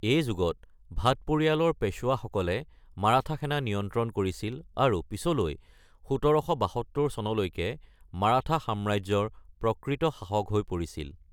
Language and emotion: Assamese, neutral